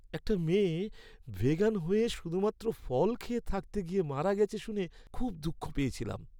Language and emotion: Bengali, sad